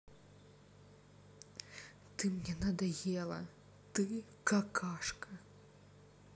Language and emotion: Russian, sad